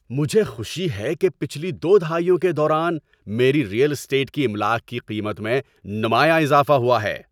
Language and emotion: Urdu, happy